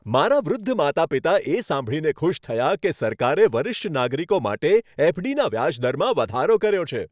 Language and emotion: Gujarati, happy